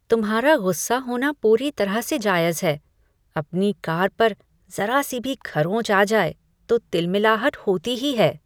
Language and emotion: Hindi, disgusted